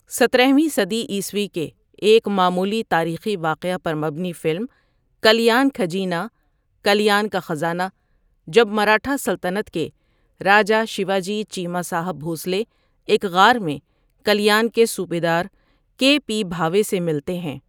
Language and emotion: Urdu, neutral